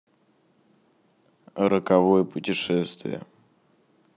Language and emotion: Russian, neutral